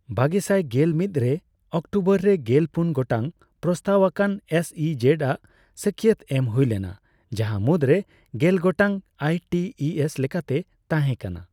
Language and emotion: Santali, neutral